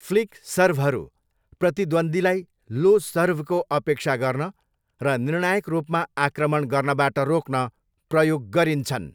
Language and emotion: Nepali, neutral